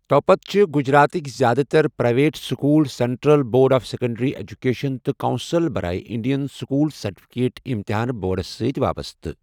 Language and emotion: Kashmiri, neutral